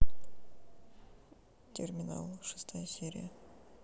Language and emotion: Russian, neutral